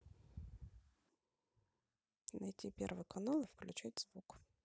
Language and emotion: Russian, neutral